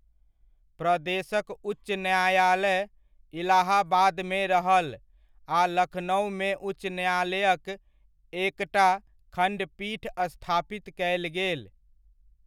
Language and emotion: Maithili, neutral